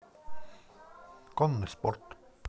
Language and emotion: Russian, neutral